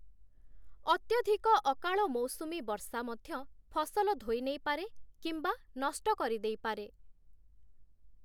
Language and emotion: Odia, neutral